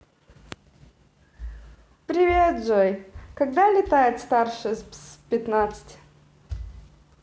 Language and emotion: Russian, positive